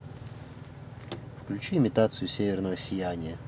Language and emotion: Russian, neutral